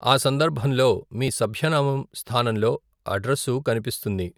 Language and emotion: Telugu, neutral